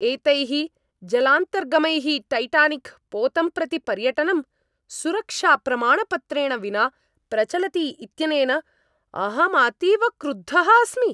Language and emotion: Sanskrit, angry